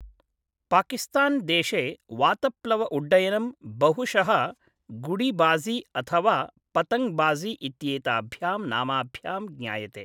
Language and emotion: Sanskrit, neutral